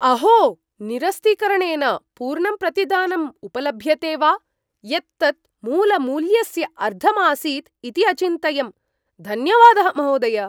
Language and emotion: Sanskrit, surprised